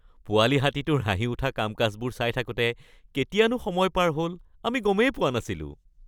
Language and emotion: Assamese, happy